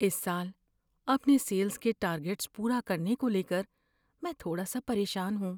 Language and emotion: Urdu, fearful